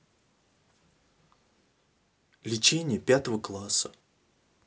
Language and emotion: Russian, neutral